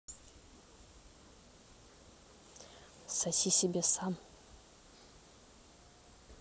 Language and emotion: Russian, neutral